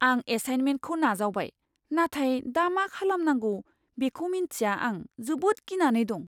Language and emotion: Bodo, fearful